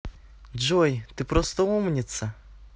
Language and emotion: Russian, positive